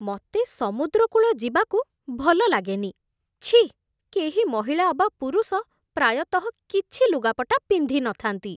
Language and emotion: Odia, disgusted